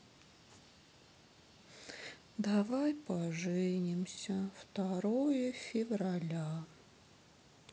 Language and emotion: Russian, sad